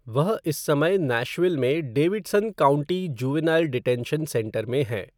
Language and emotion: Hindi, neutral